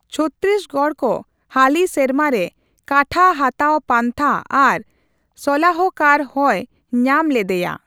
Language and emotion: Santali, neutral